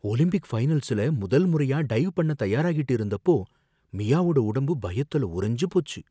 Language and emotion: Tamil, fearful